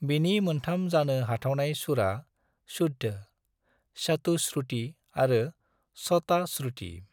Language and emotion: Bodo, neutral